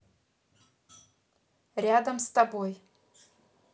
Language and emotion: Russian, neutral